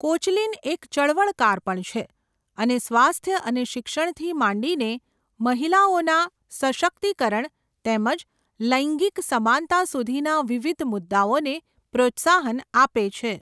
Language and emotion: Gujarati, neutral